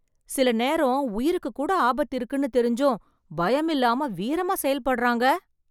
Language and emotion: Tamil, surprised